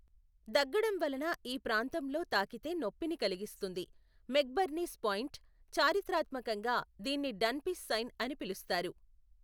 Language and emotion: Telugu, neutral